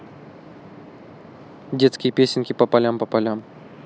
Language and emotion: Russian, neutral